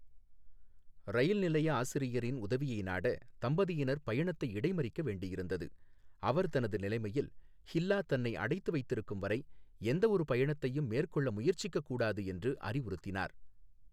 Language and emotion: Tamil, neutral